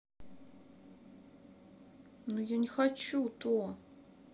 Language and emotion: Russian, sad